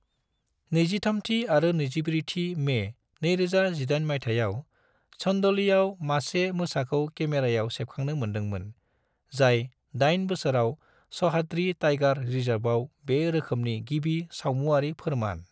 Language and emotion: Bodo, neutral